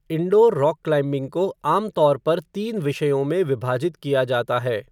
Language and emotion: Hindi, neutral